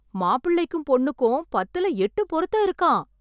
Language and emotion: Tamil, happy